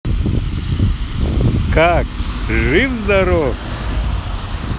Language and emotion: Russian, positive